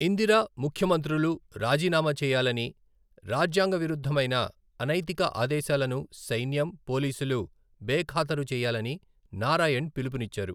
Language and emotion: Telugu, neutral